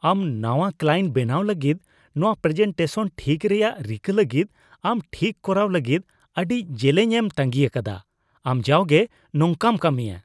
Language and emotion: Santali, disgusted